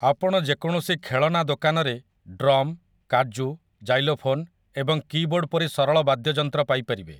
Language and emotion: Odia, neutral